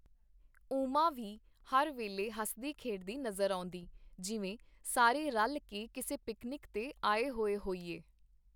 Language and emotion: Punjabi, neutral